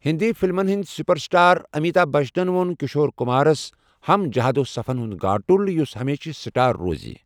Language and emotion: Kashmiri, neutral